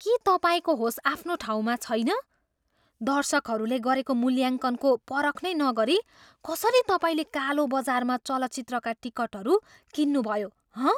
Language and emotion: Nepali, surprised